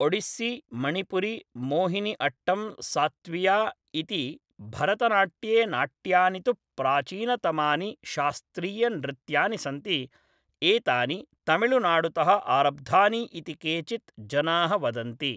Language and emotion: Sanskrit, neutral